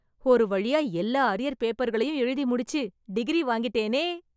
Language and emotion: Tamil, happy